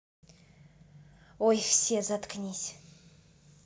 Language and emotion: Russian, angry